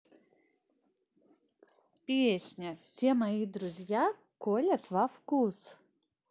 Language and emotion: Russian, positive